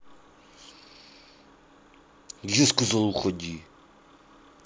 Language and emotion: Russian, angry